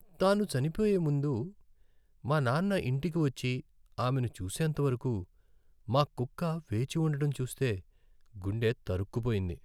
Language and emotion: Telugu, sad